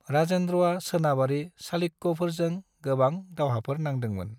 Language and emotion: Bodo, neutral